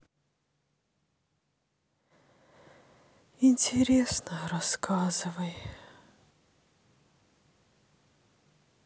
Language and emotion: Russian, sad